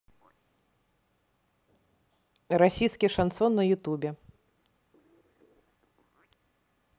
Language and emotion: Russian, neutral